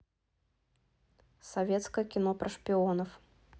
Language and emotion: Russian, neutral